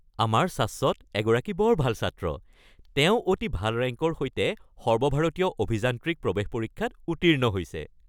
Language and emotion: Assamese, happy